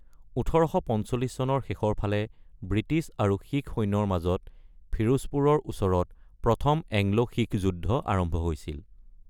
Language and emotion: Assamese, neutral